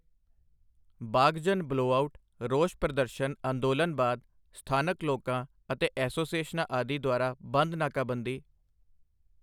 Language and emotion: Punjabi, neutral